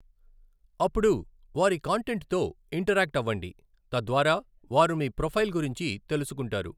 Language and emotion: Telugu, neutral